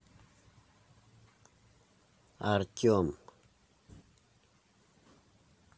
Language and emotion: Russian, neutral